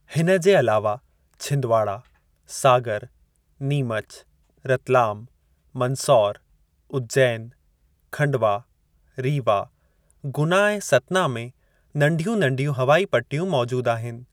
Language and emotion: Sindhi, neutral